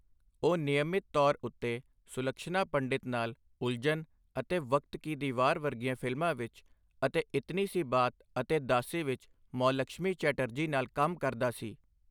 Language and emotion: Punjabi, neutral